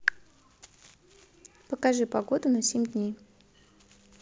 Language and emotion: Russian, neutral